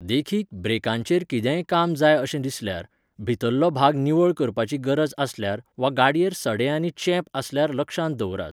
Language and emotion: Goan Konkani, neutral